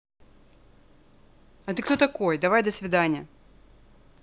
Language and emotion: Russian, neutral